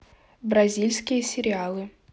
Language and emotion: Russian, neutral